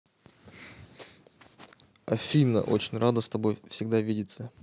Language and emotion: Russian, neutral